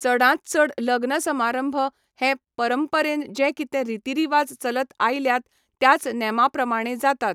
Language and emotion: Goan Konkani, neutral